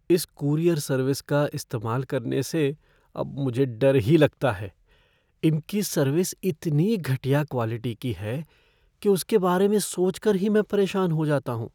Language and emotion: Hindi, fearful